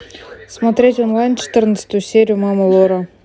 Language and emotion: Russian, neutral